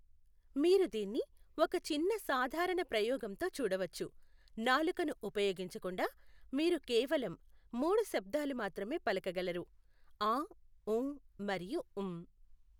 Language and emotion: Telugu, neutral